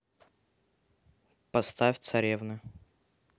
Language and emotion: Russian, neutral